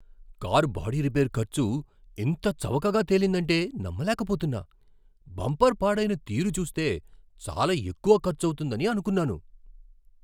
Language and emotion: Telugu, surprised